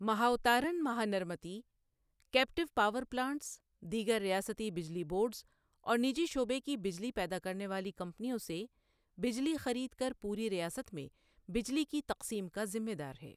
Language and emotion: Urdu, neutral